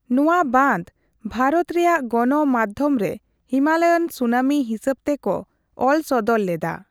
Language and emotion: Santali, neutral